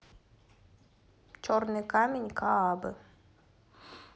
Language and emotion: Russian, neutral